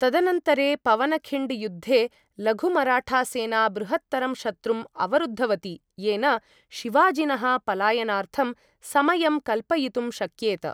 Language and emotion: Sanskrit, neutral